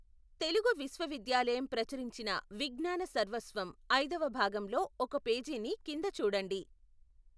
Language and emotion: Telugu, neutral